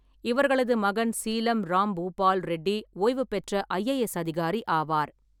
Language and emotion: Tamil, neutral